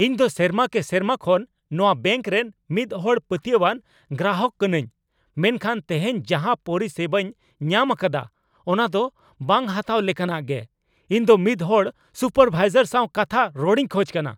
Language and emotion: Santali, angry